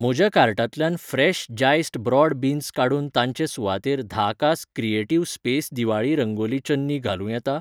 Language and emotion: Goan Konkani, neutral